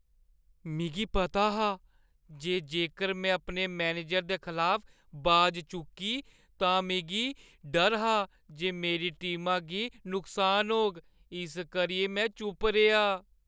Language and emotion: Dogri, fearful